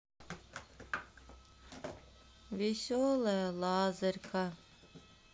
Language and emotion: Russian, sad